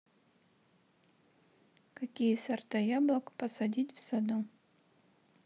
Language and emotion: Russian, neutral